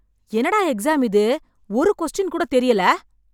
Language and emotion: Tamil, angry